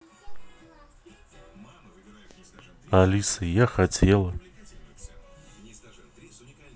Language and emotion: Russian, neutral